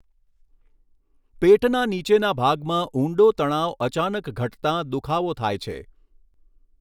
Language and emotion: Gujarati, neutral